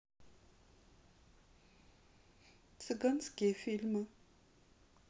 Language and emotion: Russian, sad